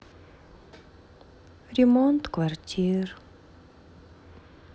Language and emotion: Russian, sad